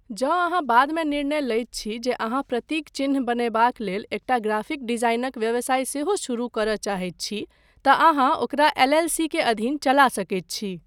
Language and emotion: Maithili, neutral